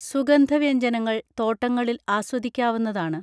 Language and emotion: Malayalam, neutral